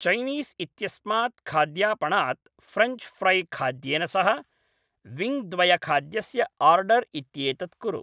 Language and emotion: Sanskrit, neutral